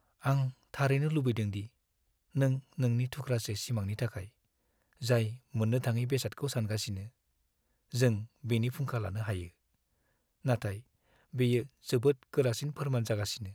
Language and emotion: Bodo, sad